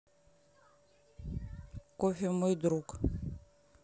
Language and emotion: Russian, neutral